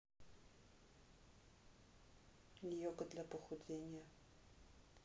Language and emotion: Russian, neutral